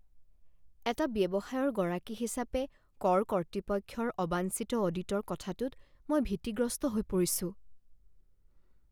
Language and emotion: Assamese, fearful